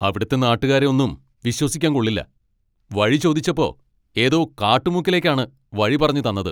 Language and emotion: Malayalam, angry